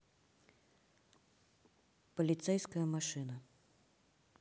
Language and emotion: Russian, neutral